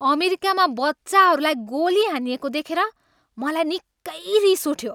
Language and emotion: Nepali, angry